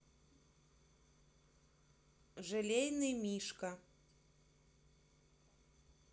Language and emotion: Russian, neutral